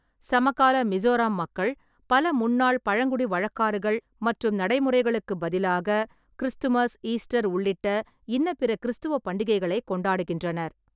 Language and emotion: Tamil, neutral